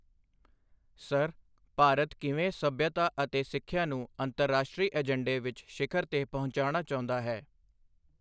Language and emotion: Punjabi, neutral